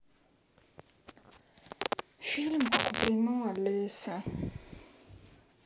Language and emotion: Russian, sad